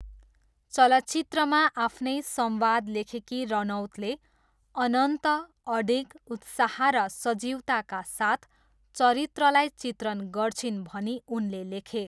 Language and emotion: Nepali, neutral